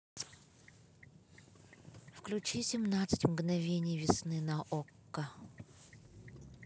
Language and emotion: Russian, neutral